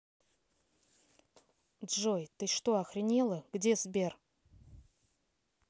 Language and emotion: Russian, angry